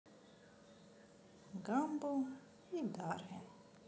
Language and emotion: Russian, neutral